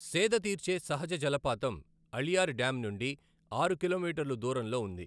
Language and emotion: Telugu, neutral